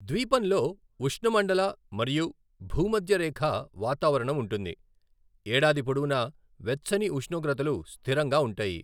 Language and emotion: Telugu, neutral